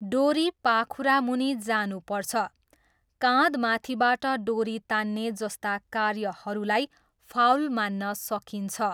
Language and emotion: Nepali, neutral